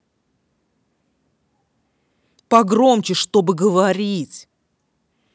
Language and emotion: Russian, angry